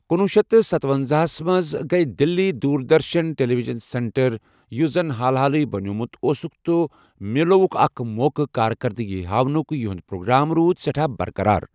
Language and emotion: Kashmiri, neutral